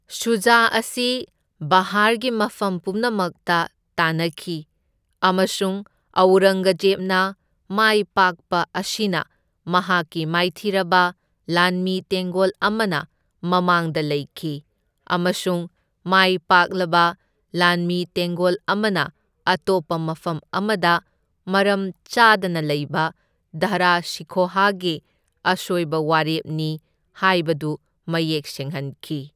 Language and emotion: Manipuri, neutral